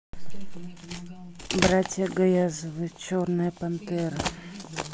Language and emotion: Russian, neutral